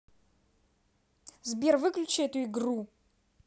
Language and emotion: Russian, angry